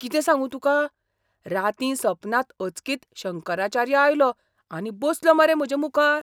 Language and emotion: Goan Konkani, surprised